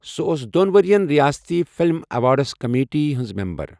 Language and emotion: Kashmiri, neutral